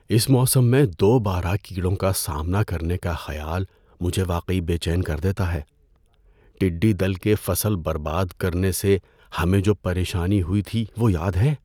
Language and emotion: Urdu, fearful